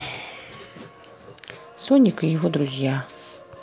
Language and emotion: Russian, neutral